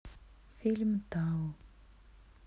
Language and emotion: Russian, sad